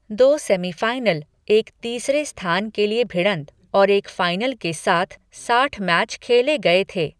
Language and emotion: Hindi, neutral